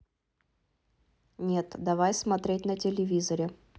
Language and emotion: Russian, neutral